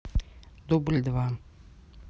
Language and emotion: Russian, neutral